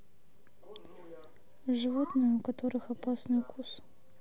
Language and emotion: Russian, neutral